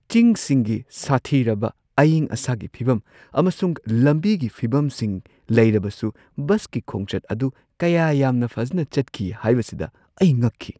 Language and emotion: Manipuri, surprised